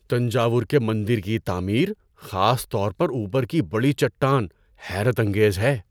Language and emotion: Urdu, surprised